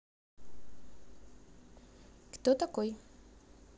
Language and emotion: Russian, neutral